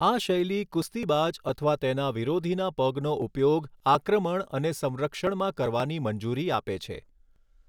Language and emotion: Gujarati, neutral